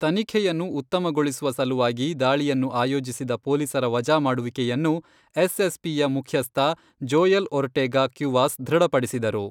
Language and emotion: Kannada, neutral